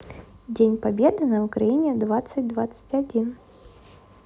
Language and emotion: Russian, neutral